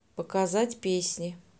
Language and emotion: Russian, neutral